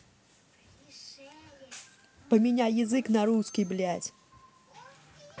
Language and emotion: Russian, angry